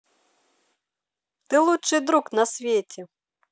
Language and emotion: Russian, positive